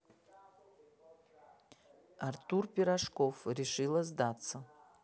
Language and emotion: Russian, neutral